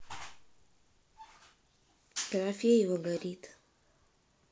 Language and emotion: Russian, sad